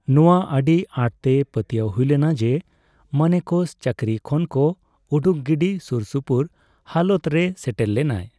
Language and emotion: Santali, neutral